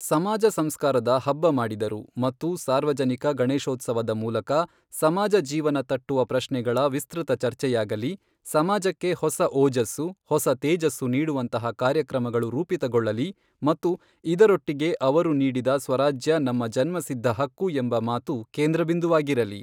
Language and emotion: Kannada, neutral